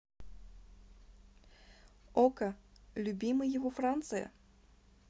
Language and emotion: Russian, neutral